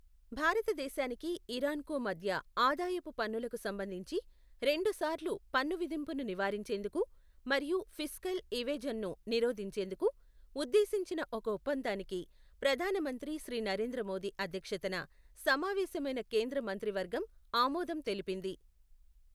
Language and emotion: Telugu, neutral